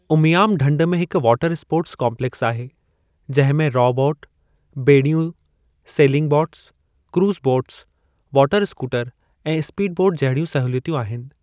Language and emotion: Sindhi, neutral